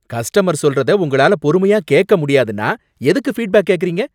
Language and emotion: Tamil, angry